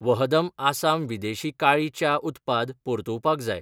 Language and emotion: Goan Konkani, neutral